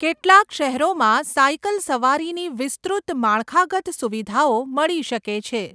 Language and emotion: Gujarati, neutral